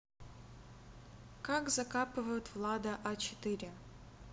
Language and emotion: Russian, neutral